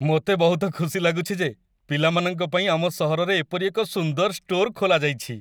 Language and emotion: Odia, happy